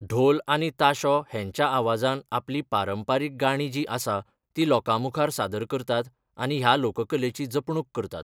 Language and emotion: Goan Konkani, neutral